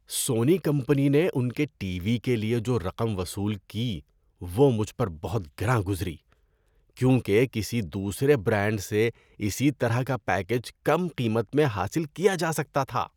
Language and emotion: Urdu, disgusted